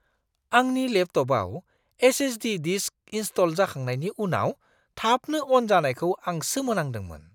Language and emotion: Bodo, surprised